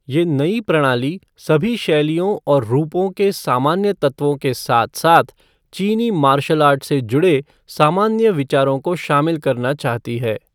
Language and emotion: Hindi, neutral